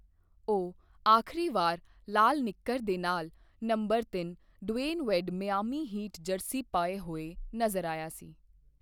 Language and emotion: Punjabi, neutral